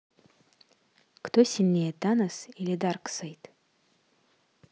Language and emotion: Russian, neutral